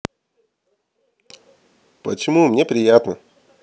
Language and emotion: Russian, positive